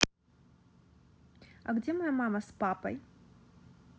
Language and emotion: Russian, neutral